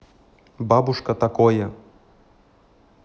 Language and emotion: Russian, neutral